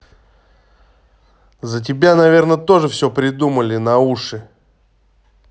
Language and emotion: Russian, angry